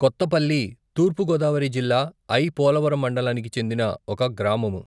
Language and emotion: Telugu, neutral